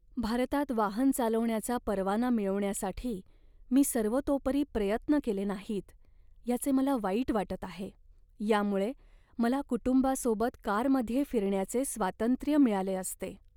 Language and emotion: Marathi, sad